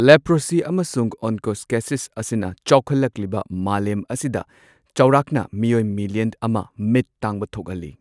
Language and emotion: Manipuri, neutral